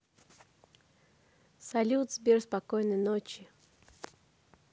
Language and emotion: Russian, neutral